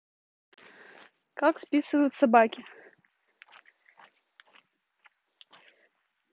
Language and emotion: Russian, neutral